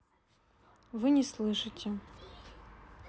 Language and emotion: Russian, neutral